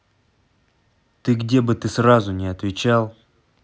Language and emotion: Russian, angry